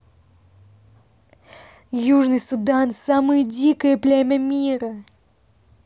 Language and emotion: Russian, positive